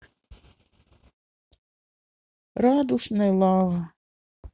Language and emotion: Russian, sad